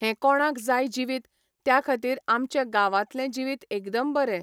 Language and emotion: Goan Konkani, neutral